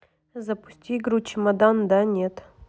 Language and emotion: Russian, neutral